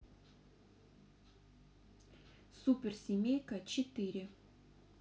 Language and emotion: Russian, neutral